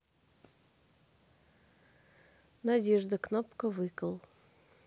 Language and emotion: Russian, neutral